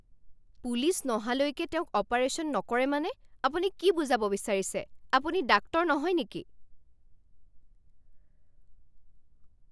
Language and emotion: Assamese, angry